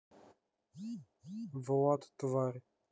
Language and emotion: Russian, neutral